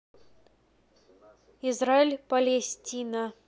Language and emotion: Russian, neutral